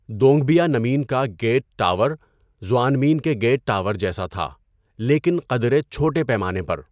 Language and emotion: Urdu, neutral